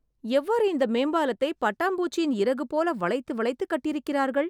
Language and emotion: Tamil, surprised